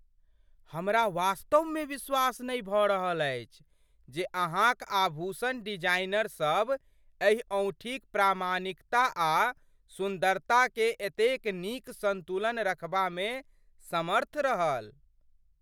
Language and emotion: Maithili, surprised